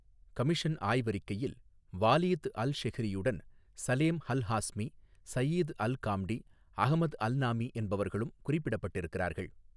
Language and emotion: Tamil, neutral